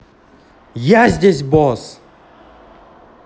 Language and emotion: Russian, angry